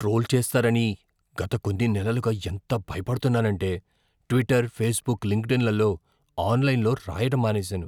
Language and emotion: Telugu, fearful